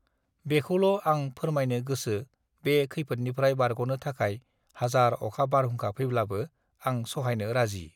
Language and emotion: Bodo, neutral